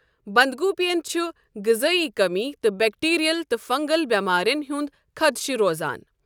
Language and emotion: Kashmiri, neutral